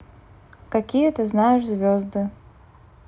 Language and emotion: Russian, neutral